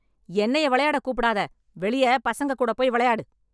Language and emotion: Tamil, angry